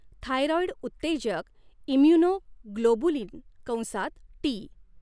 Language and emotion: Marathi, neutral